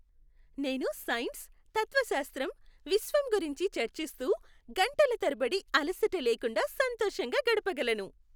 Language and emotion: Telugu, happy